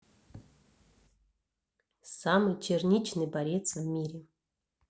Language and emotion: Russian, neutral